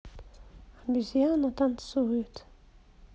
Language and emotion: Russian, sad